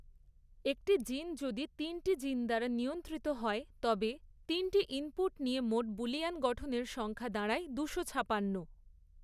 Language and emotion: Bengali, neutral